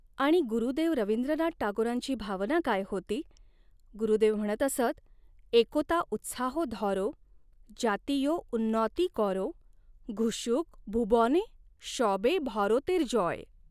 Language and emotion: Marathi, neutral